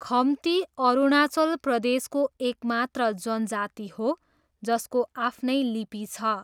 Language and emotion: Nepali, neutral